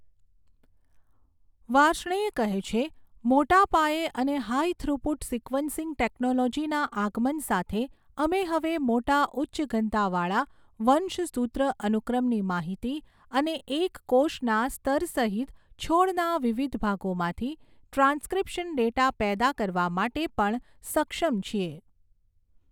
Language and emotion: Gujarati, neutral